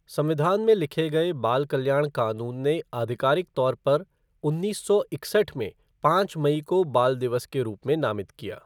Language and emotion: Hindi, neutral